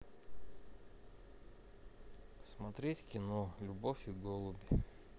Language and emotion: Russian, neutral